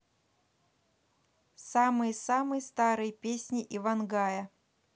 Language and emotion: Russian, neutral